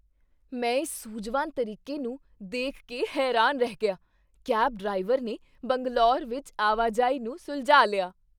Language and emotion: Punjabi, surprised